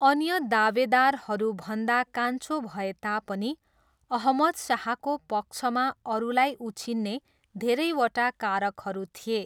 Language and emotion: Nepali, neutral